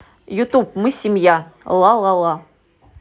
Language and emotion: Russian, positive